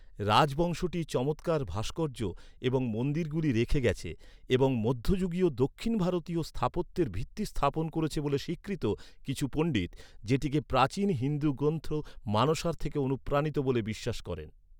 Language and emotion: Bengali, neutral